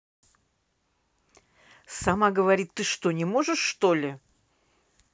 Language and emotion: Russian, angry